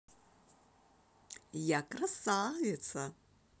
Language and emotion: Russian, positive